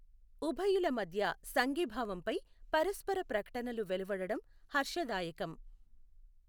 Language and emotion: Telugu, neutral